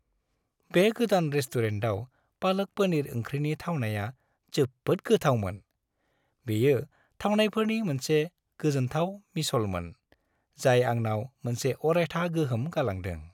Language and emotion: Bodo, happy